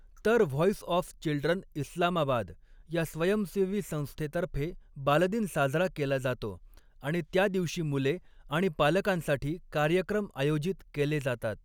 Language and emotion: Marathi, neutral